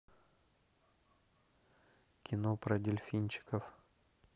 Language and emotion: Russian, neutral